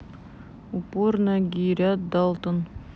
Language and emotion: Russian, neutral